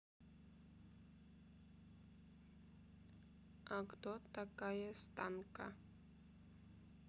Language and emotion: Russian, neutral